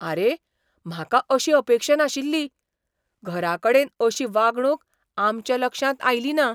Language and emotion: Goan Konkani, surprised